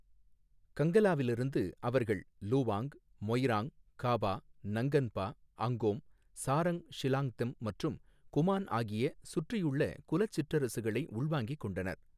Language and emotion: Tamil, neutral